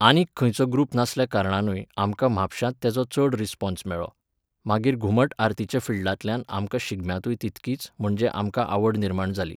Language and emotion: Goan Konkani, neutral